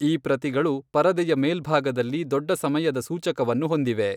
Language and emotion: Kannada, neutral